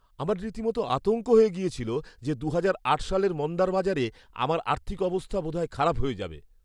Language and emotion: Bengali, fearful